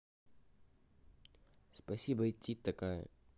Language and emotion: Russian, neutral